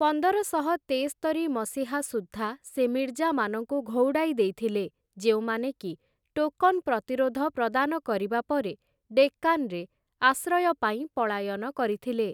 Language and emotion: Odia, neutral